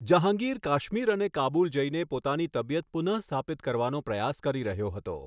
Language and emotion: Gujarati, neutral